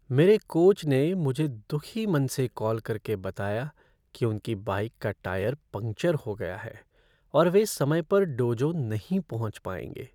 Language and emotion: Hindi, sad